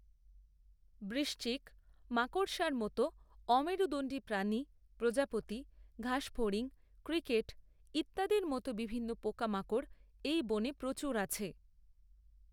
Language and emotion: Bengali, neutral